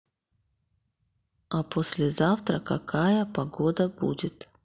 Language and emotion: Russian, neutral